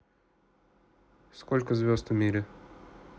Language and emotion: Russian, neutral